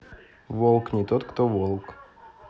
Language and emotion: Russian, neutral